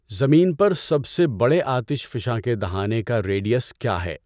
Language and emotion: Urdu, neutral